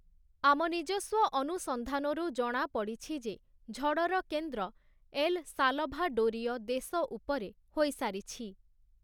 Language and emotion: Odia, neutral